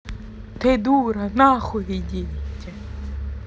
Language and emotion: Russian, angry